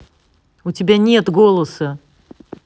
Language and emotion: Russian, angry